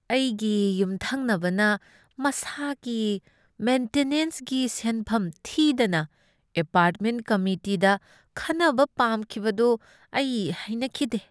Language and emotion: Manipuri, disgusted